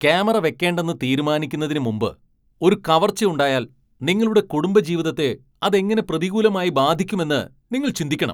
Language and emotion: Malayalam, angry